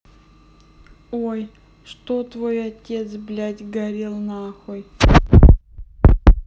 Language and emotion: Russian, neutral